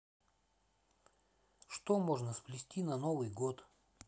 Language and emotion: Russian, neutral